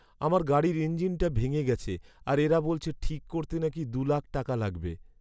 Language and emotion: Bengali, sad